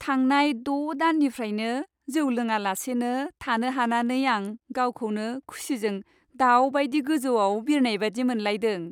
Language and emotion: Bodo, happy